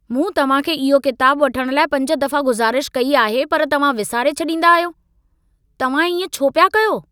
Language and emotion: Sindhi, angry